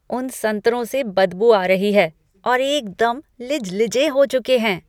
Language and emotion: Hindi, disgusted